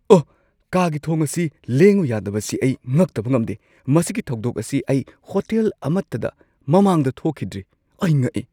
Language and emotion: Manipuri, surprised